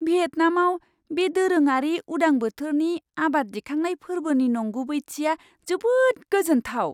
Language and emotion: Bodo, surprised